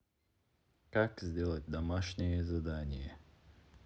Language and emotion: Russian, neutral